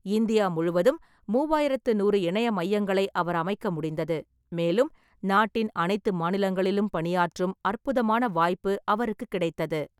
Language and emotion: Tamil, neutral